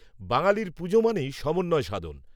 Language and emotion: Bengali, neutral